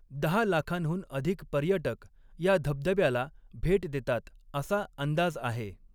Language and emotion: Marathi, neutral